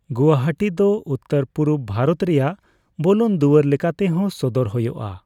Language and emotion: Santali, neutral